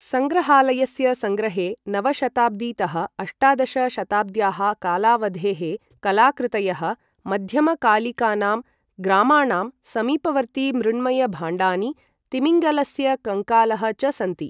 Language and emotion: Sanskrit, neutral